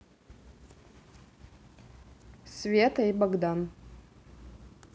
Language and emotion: Russian, neutral